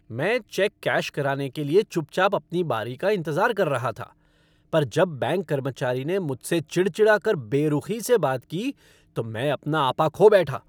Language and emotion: Hindi, angry